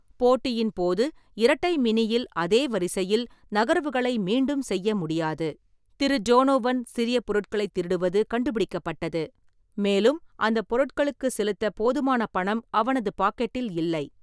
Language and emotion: Tamil, neutral